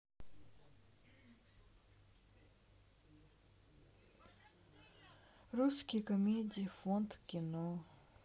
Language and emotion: Russian, sad